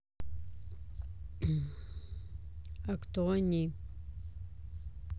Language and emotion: Russian, neutral